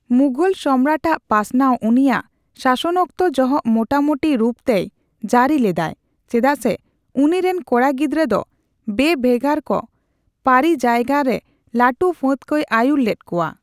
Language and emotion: Santali, neutral